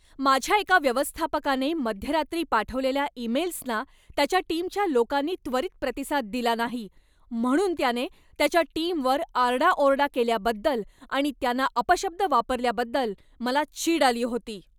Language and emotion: Marathi, angry